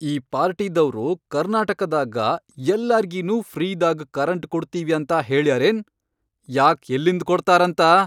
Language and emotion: Kannada, angry